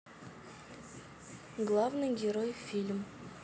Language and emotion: Russian, neutral